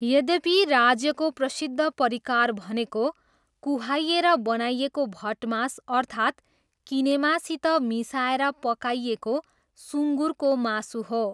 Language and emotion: Nepali, neutral